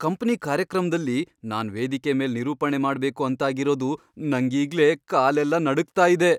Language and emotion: Kannada, fearful